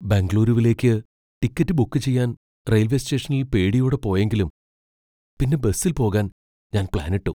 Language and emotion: Malayalam, fearful